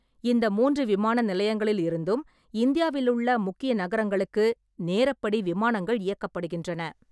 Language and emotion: Tamil, neutral